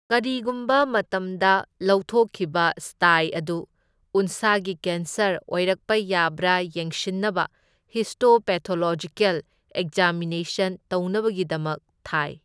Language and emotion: Manipuri, neutral